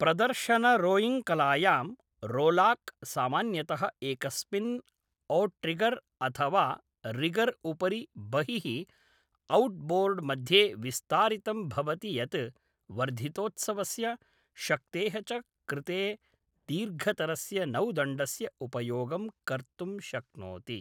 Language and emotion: Sanskrit, neutral